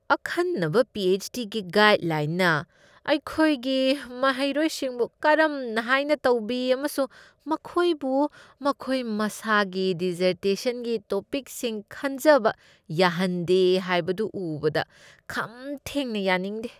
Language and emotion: Manipuri, disgusted